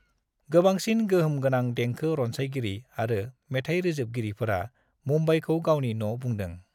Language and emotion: Bodo, neutral